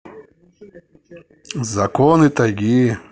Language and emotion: Russian, neutral